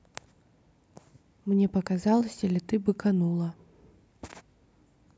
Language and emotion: Russian, neutral